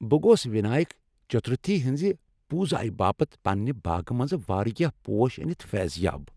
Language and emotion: Kashmiri, happy